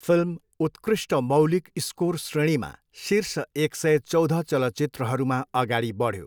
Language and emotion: Nepali, neutral